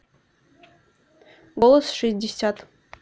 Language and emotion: Russian, neutral